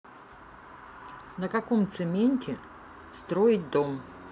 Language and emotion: Russian, neutral